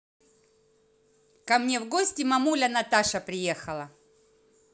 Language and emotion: Russian, positive